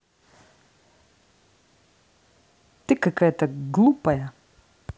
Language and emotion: Russian, angry